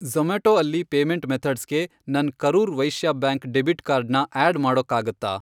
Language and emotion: Kannada, neutral